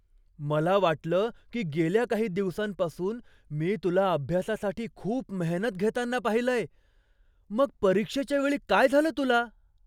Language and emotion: Marathi, surprised